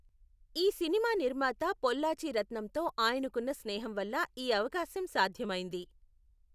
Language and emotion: Telugu, neutral